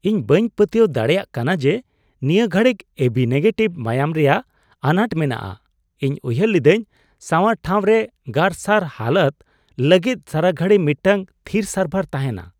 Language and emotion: Santali, surprised